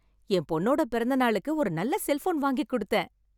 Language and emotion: Tamil, happy